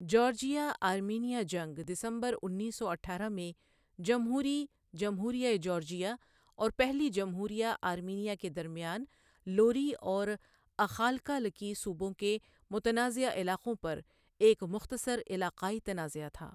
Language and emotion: Urdu, neutral